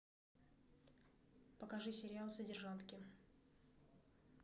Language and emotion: Russian, neutral